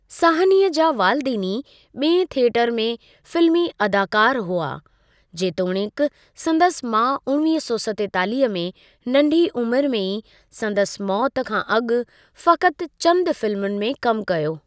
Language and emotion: Sindhi, neutral